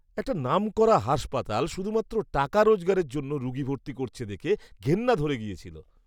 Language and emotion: Bengali, disgusted